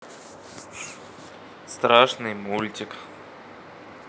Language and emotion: Russian, neutral